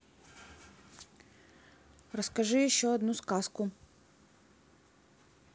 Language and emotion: Russian, neutral